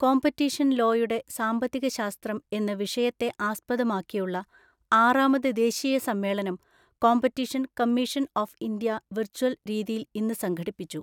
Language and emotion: Malayalam, neutral